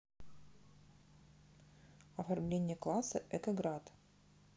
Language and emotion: Russian, neutral